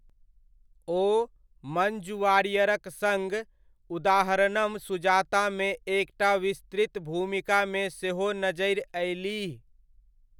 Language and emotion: Maithili, neutral